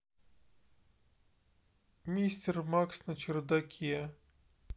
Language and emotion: Russian, sad